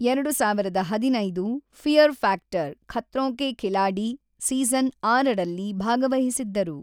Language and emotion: Kannada, neutral